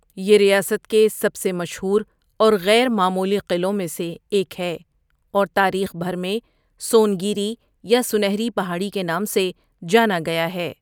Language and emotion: Urdu, neutral